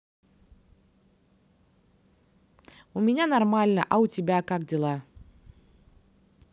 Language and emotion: Russian, positive